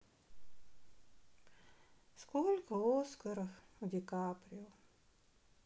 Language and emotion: Russian, sad